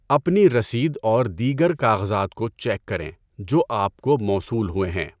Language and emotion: Urdu, neutral